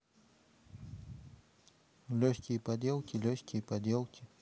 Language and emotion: Russian, neutral